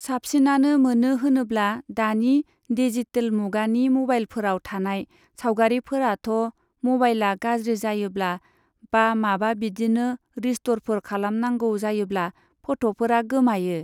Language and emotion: Bodo, neutral